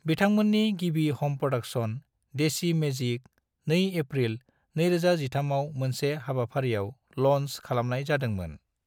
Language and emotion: Bodo, neutral